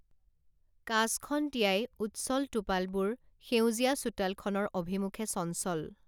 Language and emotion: Assamese, neutral